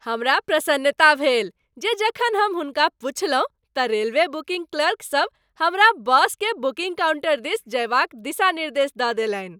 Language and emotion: Maithili, happy